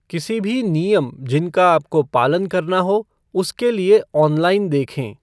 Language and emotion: Hindi, neutral